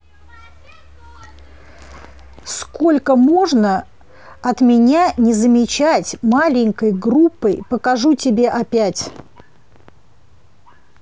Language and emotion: Russian, angry